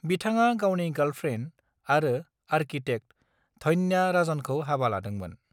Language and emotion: Bodo, neutral